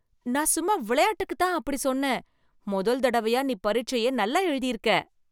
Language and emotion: Tamil, happy